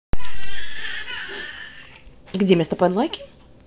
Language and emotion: Russian, neutral